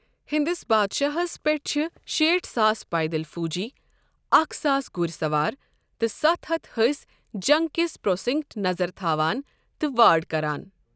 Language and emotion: Kashmiri, neutral